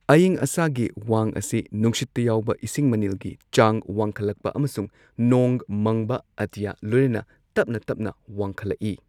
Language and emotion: Manipuri, neutral